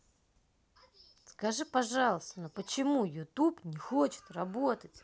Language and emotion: Russian, neutral